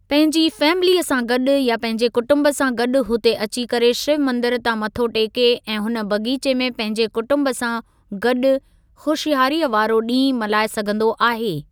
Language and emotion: Sindhi, neutral